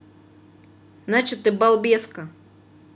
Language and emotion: Russian, angry